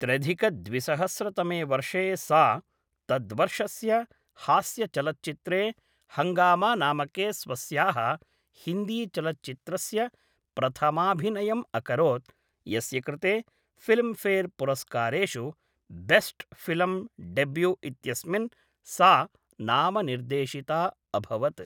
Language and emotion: Sanskrit, neutral